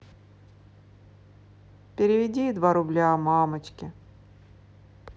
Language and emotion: Russian, sad